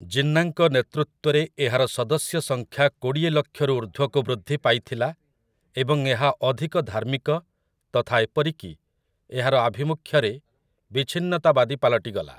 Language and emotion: Odia, neutral